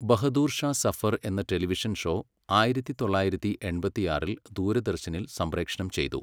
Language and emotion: Malayalam, neutral